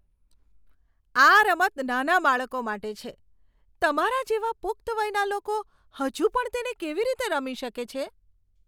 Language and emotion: Gujarati, disgusted